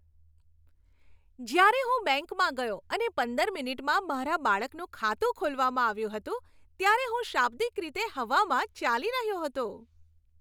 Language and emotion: Gujarati, happy